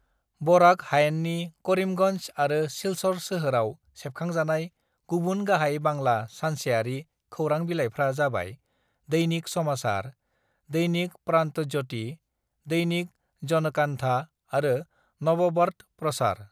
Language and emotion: Bodo, neutral